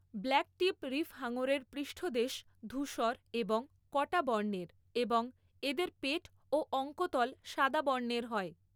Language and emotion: Bengali, neutral